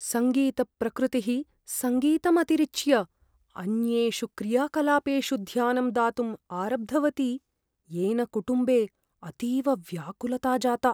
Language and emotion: Sanskrit, fearful